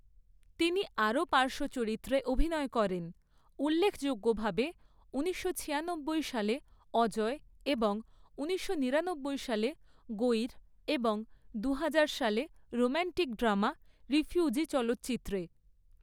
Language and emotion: Bengali, neutral